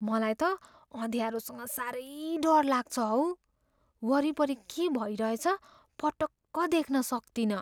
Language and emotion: Nepali, fearful